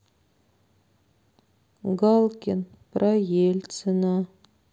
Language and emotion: Russian, sad